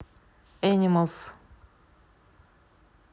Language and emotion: Russian, neutral